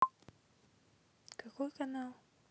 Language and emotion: Russian, neutral